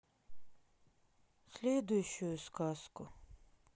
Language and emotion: Russian, sad